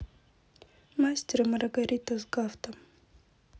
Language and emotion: Russian, neutral